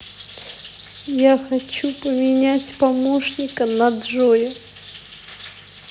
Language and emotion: Russian, sad